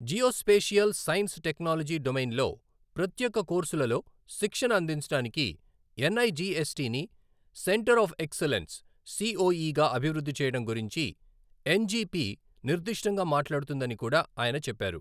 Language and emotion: Telugu, neutral